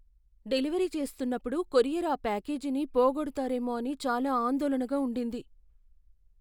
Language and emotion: Telugu, fearful